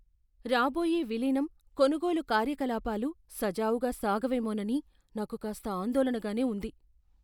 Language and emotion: Telugu, fearful